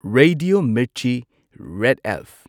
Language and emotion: Manipuri, neutral